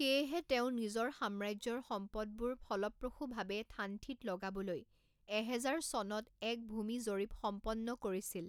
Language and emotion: Assamese, neutral